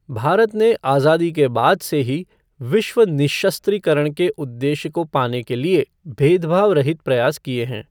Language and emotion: Hindi, neutral